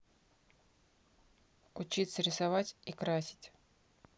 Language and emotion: Russian, neutral